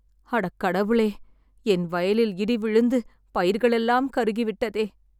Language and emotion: Tamil, sad